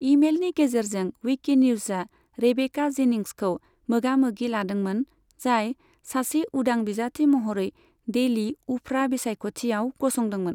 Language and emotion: Bodo, neutral